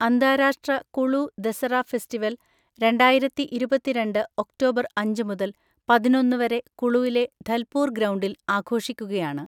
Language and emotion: Malayalam, neutral